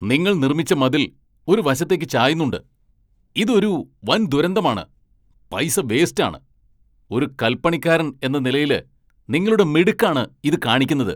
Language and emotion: Malayalam, angry